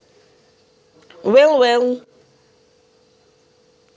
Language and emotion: Russian, neutral